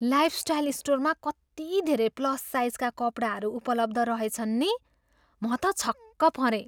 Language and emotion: Nepali, surprised